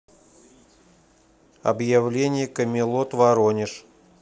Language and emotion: Russian, neutral